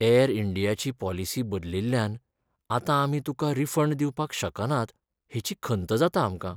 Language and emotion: Goan Konkani, sad